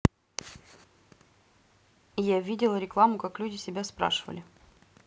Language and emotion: Russian, neutral